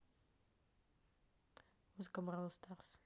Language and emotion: Russian, neutral